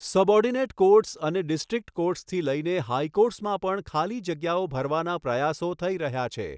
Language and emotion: Gujarati, neutral